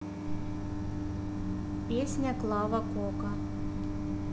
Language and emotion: Russian, neutral